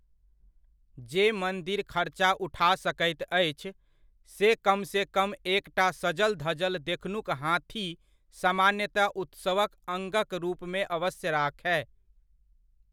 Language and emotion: Maithili, neutral